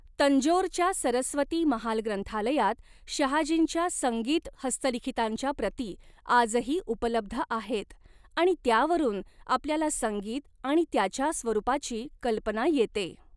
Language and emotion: Marathi, neutral